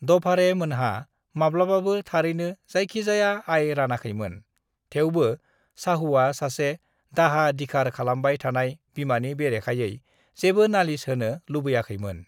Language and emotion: Bodo, neutral